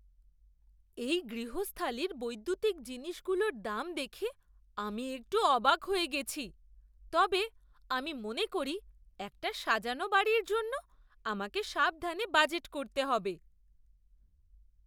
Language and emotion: Bengali, surprised